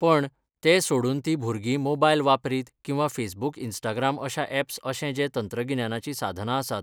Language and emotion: Goan Konkani, neutral